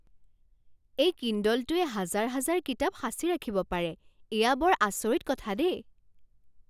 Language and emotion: Assamese, surprised